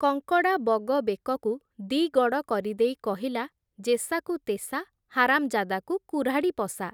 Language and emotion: Odia, neutral